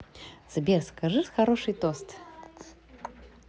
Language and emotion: Russian, positive